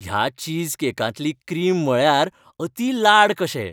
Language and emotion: Goan Konkani, happy